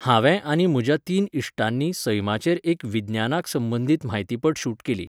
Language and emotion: Goan Konkani, neutral